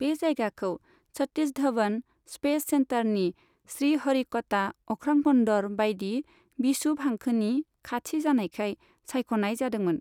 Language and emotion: Bodo, neutral